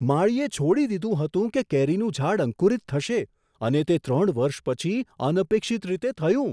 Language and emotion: Gujarati, surprised